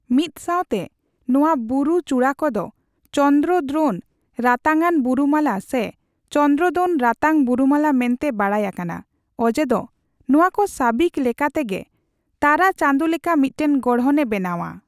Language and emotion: Santali, neutral